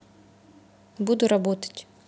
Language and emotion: Russian, neutral